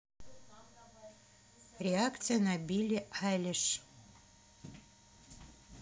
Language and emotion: Russian, neutral